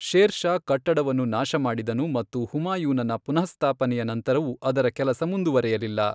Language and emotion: Kannada, neutral